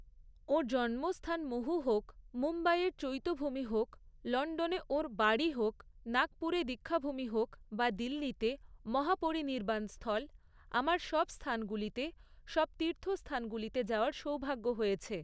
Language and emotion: Bengali, neutral